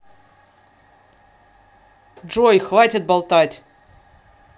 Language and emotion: Russian, angry